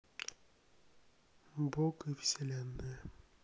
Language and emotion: Russian, neutral